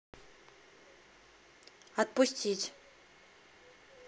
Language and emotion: Russian, neutral